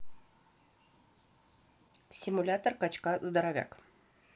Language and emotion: Russian, neutral